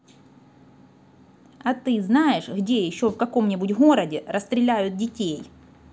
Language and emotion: Russian, angry